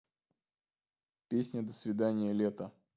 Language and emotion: Russian, neutral